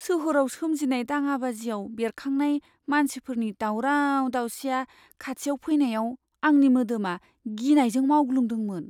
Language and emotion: Bodo, fearful